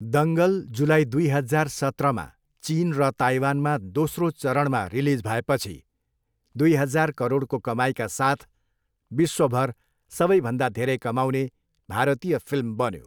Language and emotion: Nepali, neutral